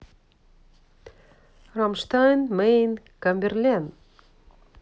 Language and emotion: Russian, neutral